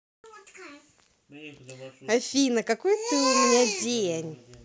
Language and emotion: Russian, positive